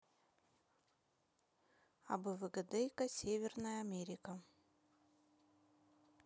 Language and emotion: Russian, neutral